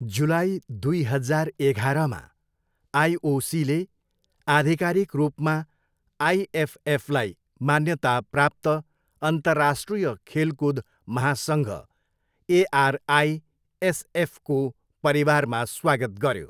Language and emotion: Nepali, neutral